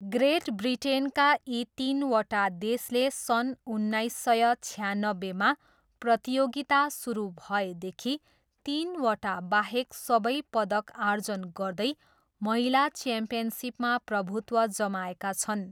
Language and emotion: Nepali, neutral